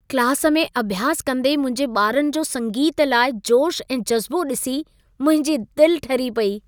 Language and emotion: Sindhi, happy